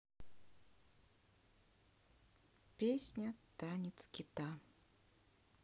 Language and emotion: Russian, sad